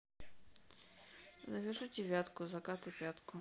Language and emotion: Russian, neutral